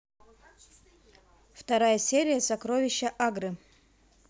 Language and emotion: Russian, neutral